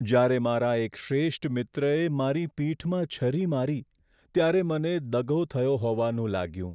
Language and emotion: Gujarati, sad